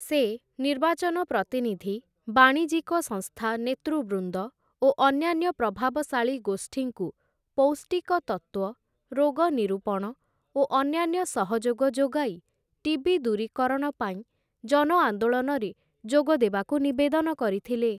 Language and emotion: Odia, neutral